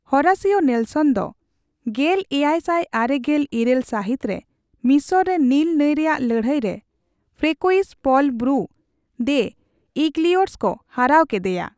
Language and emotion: Santali, neutral